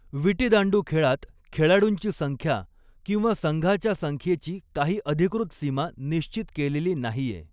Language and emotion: Marathi, neutral